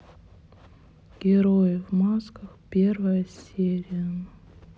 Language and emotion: Russian, sad